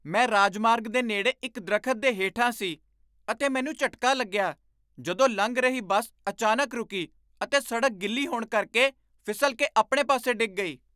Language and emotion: Punjabi, surprised